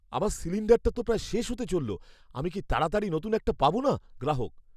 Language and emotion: Bengali, fearful